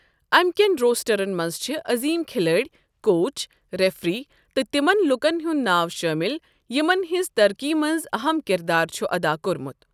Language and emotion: Kashmiri, neutral